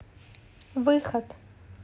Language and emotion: Russian, neutral